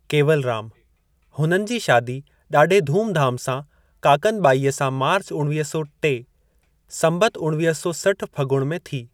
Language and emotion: Sindhi, neutral